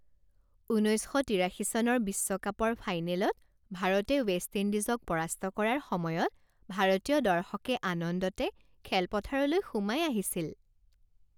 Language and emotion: Assamese, happy